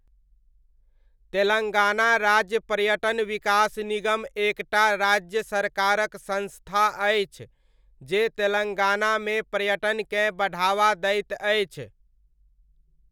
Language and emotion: Maithili, neutral